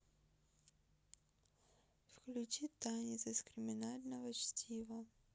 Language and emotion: Russian, neutral